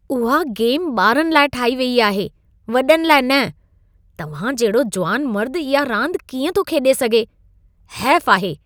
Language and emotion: Sindhi, disgusted